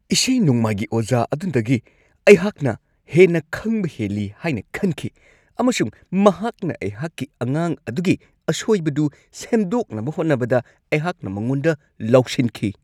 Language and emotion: Manipuri, angry